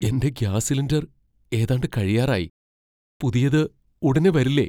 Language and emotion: Malayalam, fearful